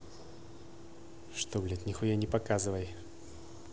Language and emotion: Russian, angry